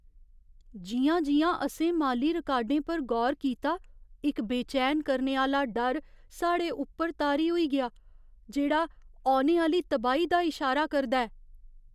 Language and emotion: Dogri, fearful